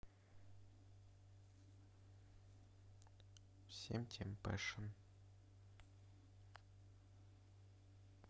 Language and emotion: Russian, neutral